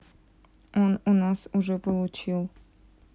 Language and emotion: Russian, neutral